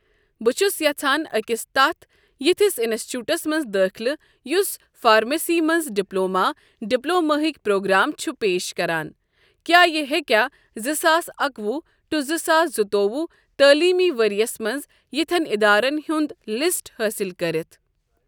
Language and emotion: Kashmiri, neutral